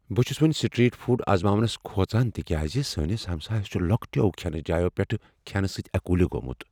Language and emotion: Kashmiri, fearful